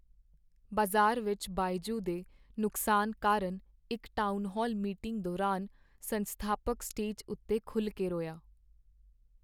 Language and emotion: Punjabi, sad